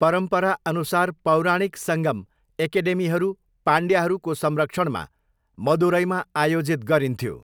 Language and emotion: Nepali, neutral